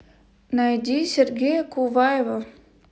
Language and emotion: Russian, neutral